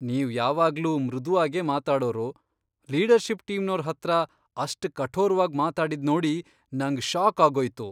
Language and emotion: Kannada, surprised